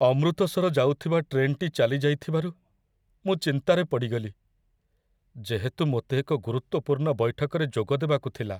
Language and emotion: Odia, sad